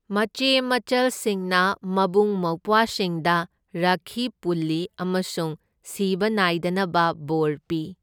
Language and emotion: Manipuri, neutral